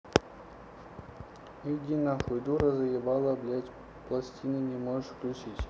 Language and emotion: Russian, neutral